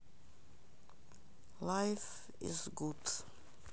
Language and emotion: Russian, sad